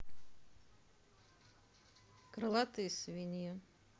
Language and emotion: Russian, neutral